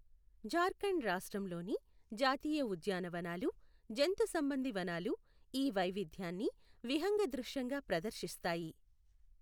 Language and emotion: Telugu, neutral